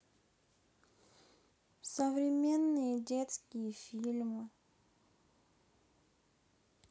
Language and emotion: Russian, sad